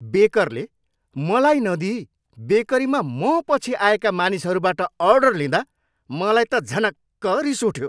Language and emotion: Nepali, angry